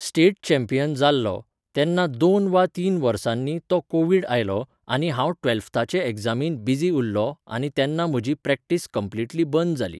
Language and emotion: Goan Konkani, neutral